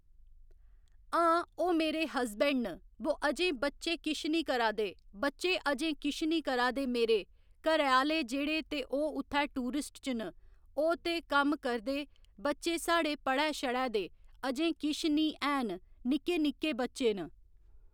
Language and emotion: Dogri, neutral